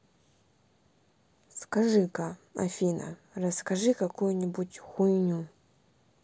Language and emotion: Russian, neutral